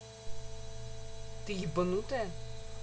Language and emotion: Russian, angry